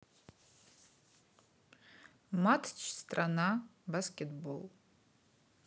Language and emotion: Russian, neutral